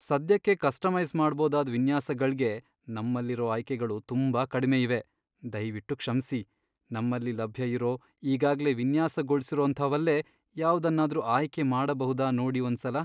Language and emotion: Kannada, sad